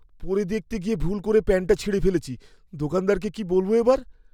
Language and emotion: Bengali, fearful